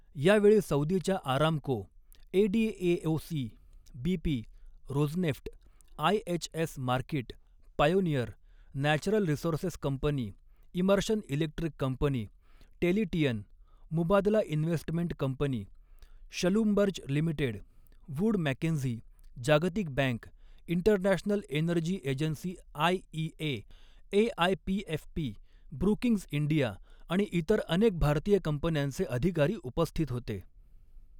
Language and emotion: Marathi, neutral